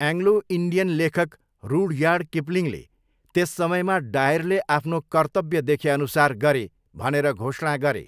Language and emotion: Nepali, neutral